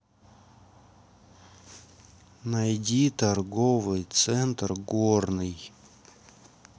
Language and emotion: Russian, neutral